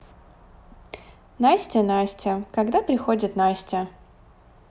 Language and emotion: Russian, neutral